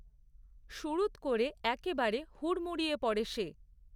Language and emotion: Bengali, neutral